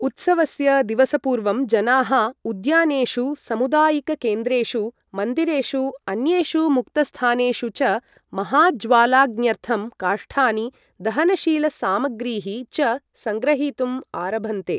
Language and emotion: Sanskrit, neutral